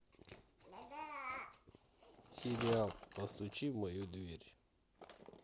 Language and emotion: Russian, neutral